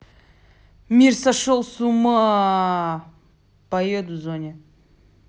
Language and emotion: Russian, angry